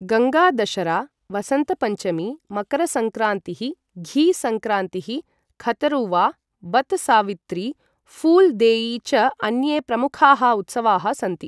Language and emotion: Sanskrit, neutral